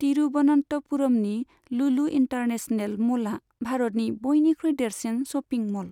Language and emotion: Bodo, neutral